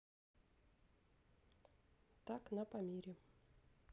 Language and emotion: Russian, neutral